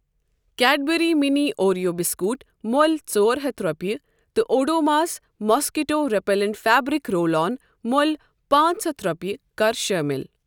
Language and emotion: Kashmiri, neutral